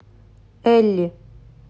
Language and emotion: Russian, neutral